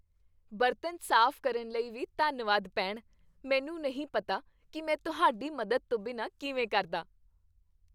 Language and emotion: Punjabi, happy